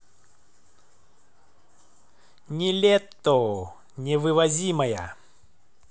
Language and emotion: Russian, positive